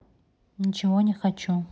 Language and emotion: Russian, neutral